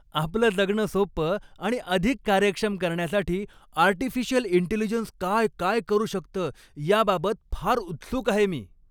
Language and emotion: Marathi, happy